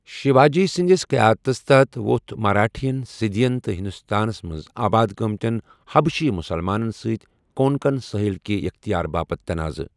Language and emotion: Kashmiri, neutral